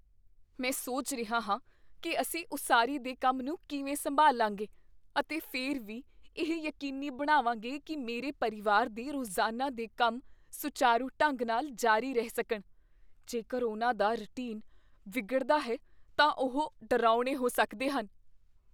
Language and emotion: Punjabi, fearful